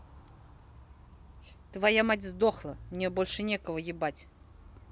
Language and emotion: Russian, angry